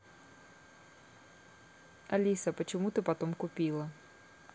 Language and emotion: Russian, neutral